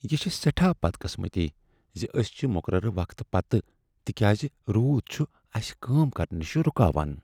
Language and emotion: Kashmiri, sad